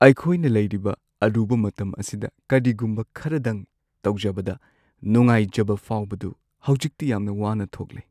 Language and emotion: Manipuri, sad